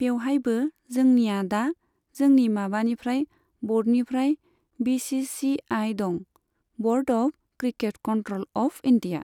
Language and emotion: Bodo, neutral